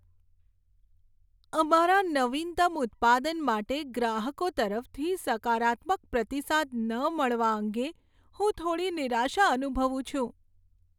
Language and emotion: Gujarati, sad